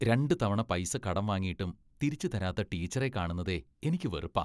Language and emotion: Malayalam, disgusted